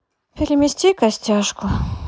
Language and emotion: Russian, sad